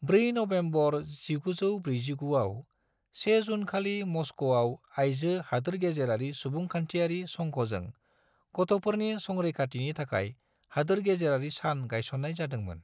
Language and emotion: Bodo, neutral